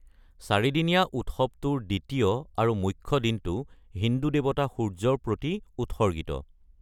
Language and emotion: Assamese, neutral